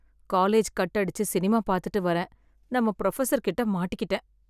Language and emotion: Tamil, sad